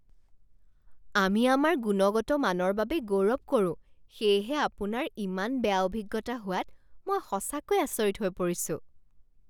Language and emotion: Assamese, surprised